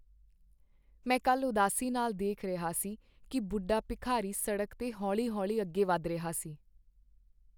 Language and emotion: Punjabi, sad